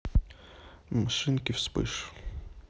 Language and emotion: Russian, neutral